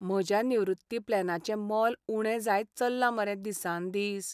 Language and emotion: Goan Konkani, sad